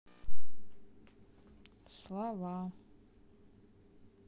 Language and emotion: Russian, neutral